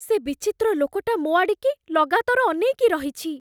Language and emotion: Odia, fearful